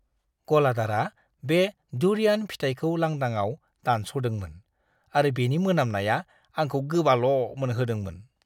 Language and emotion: Bodo, disgusted